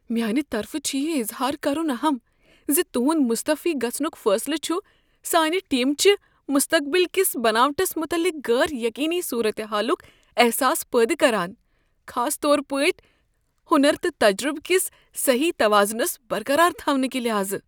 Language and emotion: Kashmiri, fearful